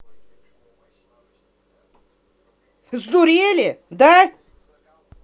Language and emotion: Russian, angry